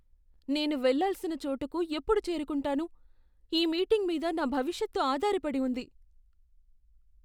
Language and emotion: Telugu, fearful